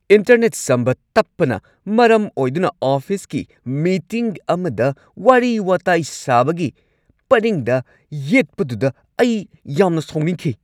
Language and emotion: Manipuri, angry